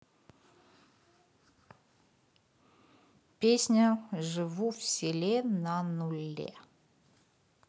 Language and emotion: Russian, neutral